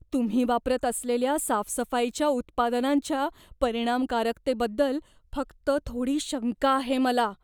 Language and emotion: Marathi, fearful